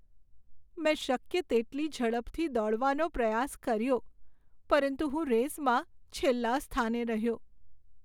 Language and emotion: Gujarati, sad